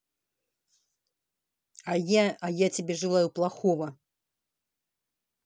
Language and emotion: Russian, angry